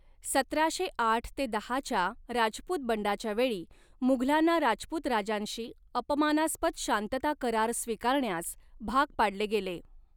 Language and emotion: Marathi, neutral